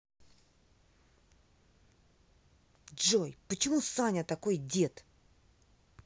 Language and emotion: Russian, angry